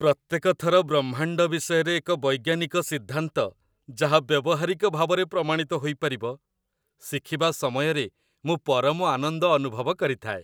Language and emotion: Odia, happy